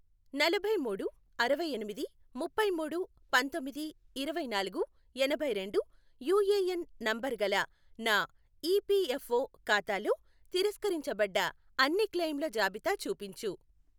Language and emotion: Telugu, neutral